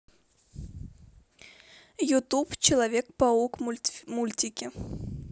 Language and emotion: Russian, neutral